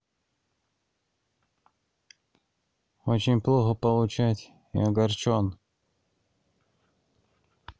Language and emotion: Russian, sad